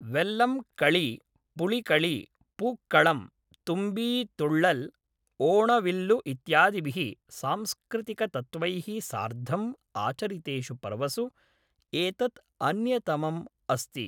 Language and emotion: Sanskrit, neutral